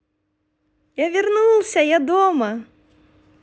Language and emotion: Russian, positive